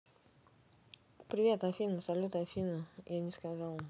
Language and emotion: Russian, neutral